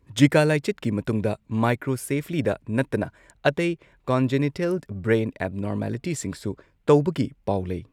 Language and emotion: Manipuri, neutral